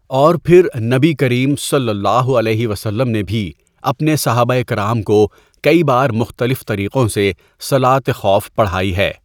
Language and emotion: Urdu, neutral